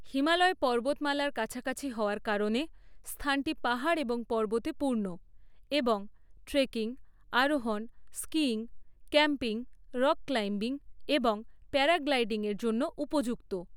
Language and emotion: Bengali, neutral